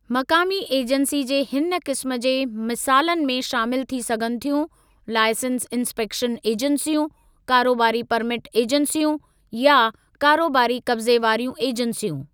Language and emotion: Sindhi, neutral